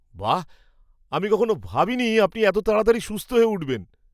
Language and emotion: Bengali, surprised